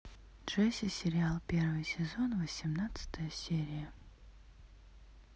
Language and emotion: Russian, neutral